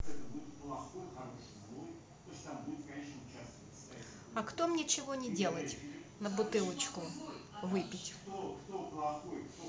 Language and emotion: Russian, neutral